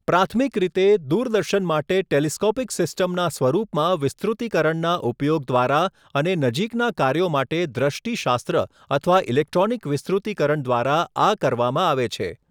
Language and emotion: Gujarati, neutral